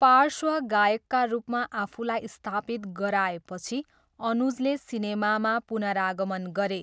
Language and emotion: Nepali, neutral